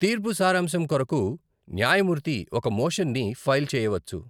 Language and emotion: Telugu, neutral